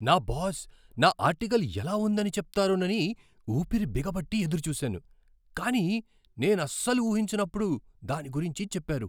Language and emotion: Telugu, surprised